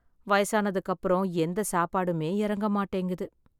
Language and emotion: Tamil, sad